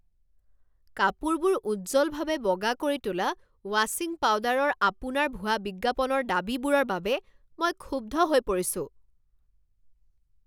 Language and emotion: Assamese, angry